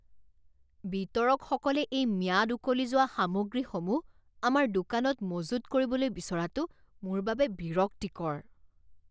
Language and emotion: Assamese, disgusted